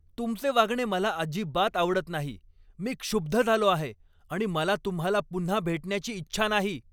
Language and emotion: Marathi, angry